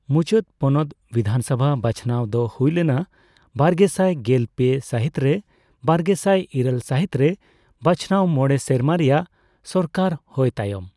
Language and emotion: Santali, neutral